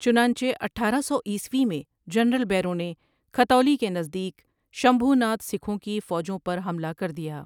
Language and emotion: Urdu, neutral